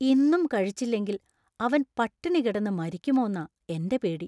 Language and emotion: Malayalam, fearful